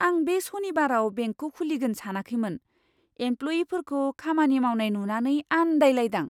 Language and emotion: Bodo, surprised